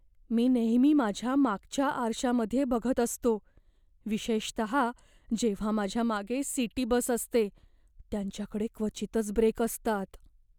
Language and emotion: Marathi, fearful